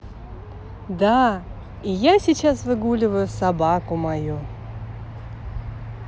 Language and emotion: Russian, positive